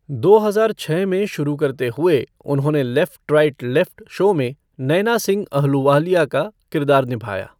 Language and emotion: Hindi, neutral